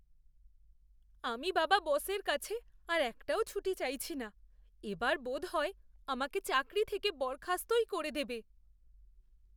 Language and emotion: Bengali, fearful